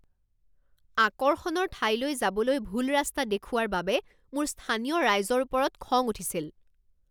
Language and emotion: Assamese, angry